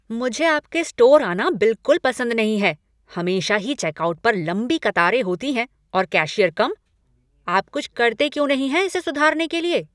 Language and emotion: Hindi, angry